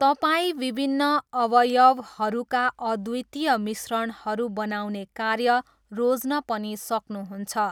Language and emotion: Nepali, neutral